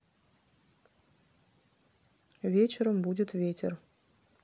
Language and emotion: Russian, neutral